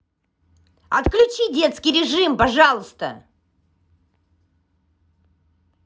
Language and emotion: Russian, angry